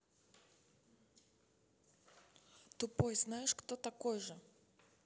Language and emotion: Russian, neutral